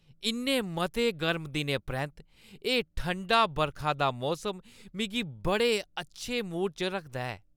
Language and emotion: Dogri, happy